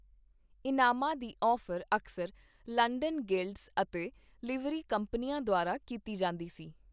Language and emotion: Punjabi, neutral